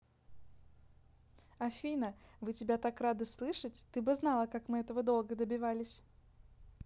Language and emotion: Russian, positive